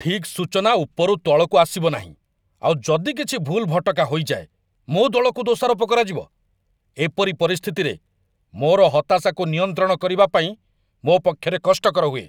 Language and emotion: Odia, angry